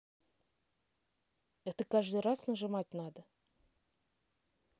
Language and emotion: Russian, neutral